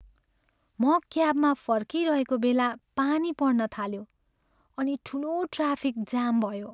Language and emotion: Nepali, sad